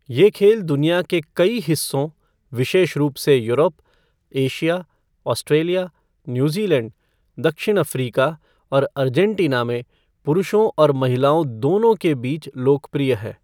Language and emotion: Hindi, neutral